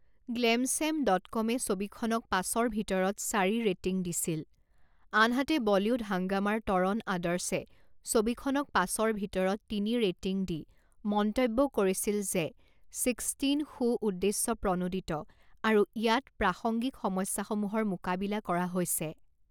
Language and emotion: Assamese, neutral